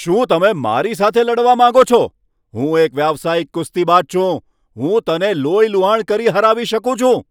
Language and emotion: Gujarati, angry